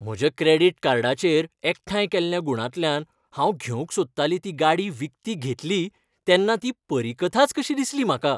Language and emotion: Goan Konkani, happy